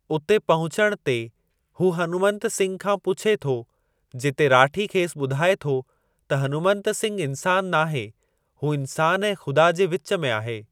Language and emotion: Sindhi, neutral